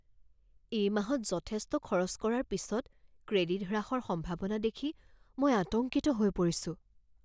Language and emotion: Assamese, fearful